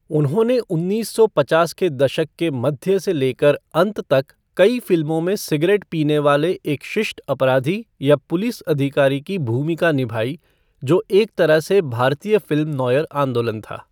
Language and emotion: Hindi, neutral